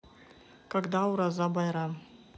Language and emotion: Russian, neutral